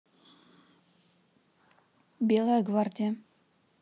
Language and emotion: Russian, neutral